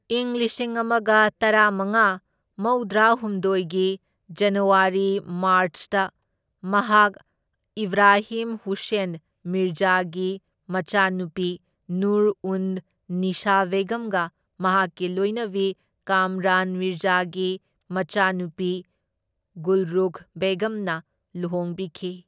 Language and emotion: Manipuri, neutral